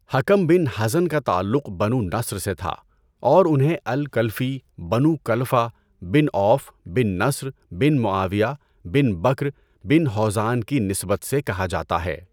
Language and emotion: Urdu, neutral